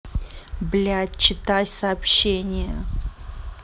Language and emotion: Russian, angry